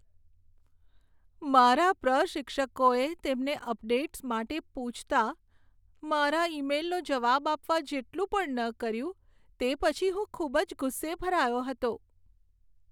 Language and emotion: Gujarati, sad